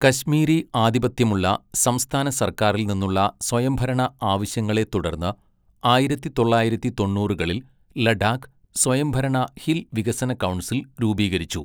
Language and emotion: Malayalam, neutral